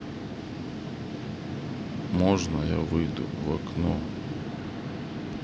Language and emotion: Russian, sad